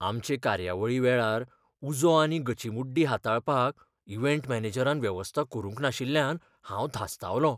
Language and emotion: Goan Konkani, fearful